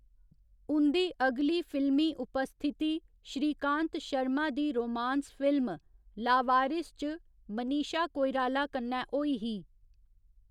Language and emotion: Dogri, neutral